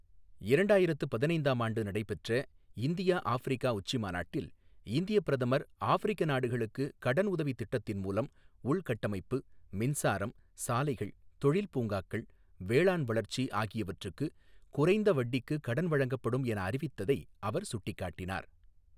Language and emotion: Tamil, neutral